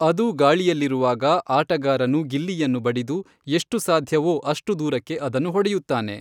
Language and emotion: Kannada, neutral